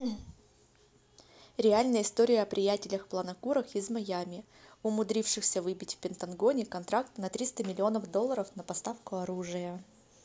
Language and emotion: Russian, neutral